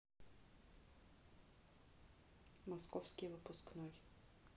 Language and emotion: Russian, neutral